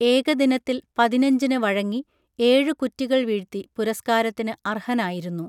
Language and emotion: Malayalam, neutral